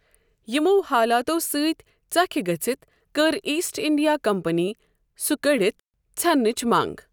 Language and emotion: Kashmiri, neutral